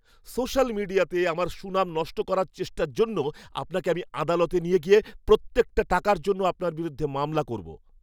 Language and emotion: Bengali, angry